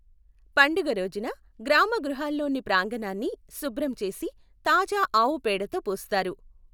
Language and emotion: Telugu, neutral